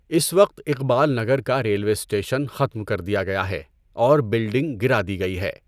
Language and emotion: Urdu, neutral